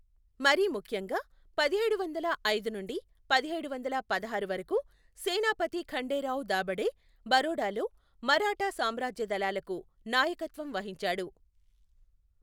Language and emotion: Telugu, neutral